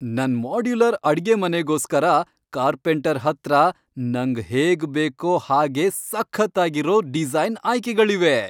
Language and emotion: Kannada, happy